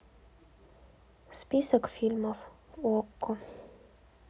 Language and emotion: Russian, sad